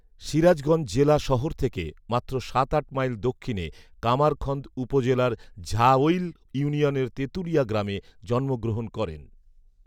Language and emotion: Bengali, neutral